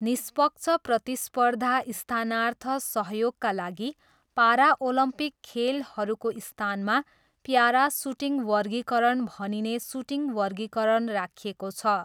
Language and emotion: Nepali, neutral